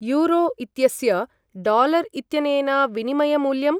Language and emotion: Sanskrit, neutral